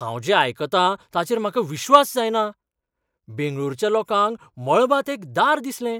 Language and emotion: Goan Konkani, surprised